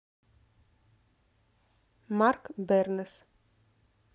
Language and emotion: Russian, neutral